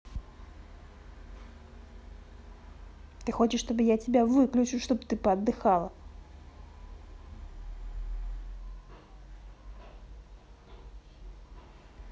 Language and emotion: Russian, angry